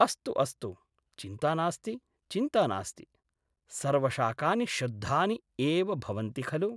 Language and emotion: Sanskrit, neutral